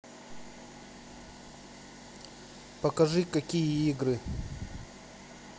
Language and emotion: Russian, neutral